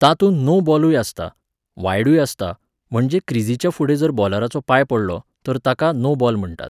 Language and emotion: Goan Konkani, neutral